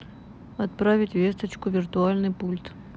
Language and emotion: Russian, neutral